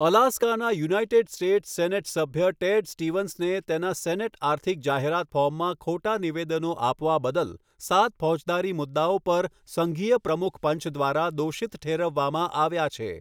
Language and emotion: Gujarati, neutral